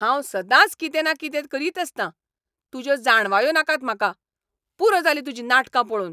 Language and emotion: Goan Konkani, angry